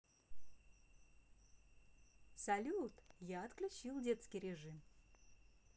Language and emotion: Russian, positive